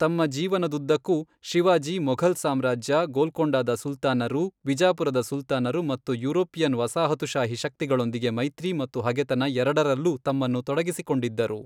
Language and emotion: Kannada, neutral